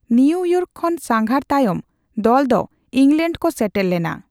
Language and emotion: Santali, neutral